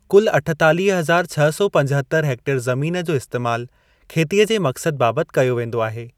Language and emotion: Sindhi, neutral